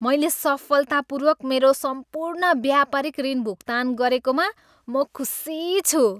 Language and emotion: Nepali, happy